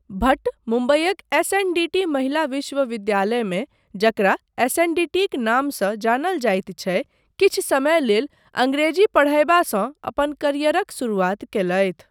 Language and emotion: Maithili, neutral